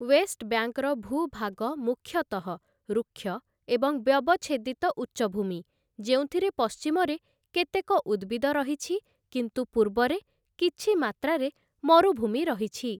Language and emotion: Odia, neutral